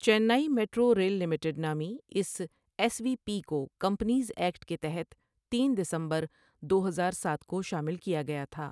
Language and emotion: Urdu, neutral